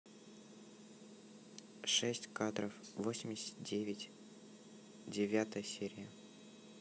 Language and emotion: Russian, neutral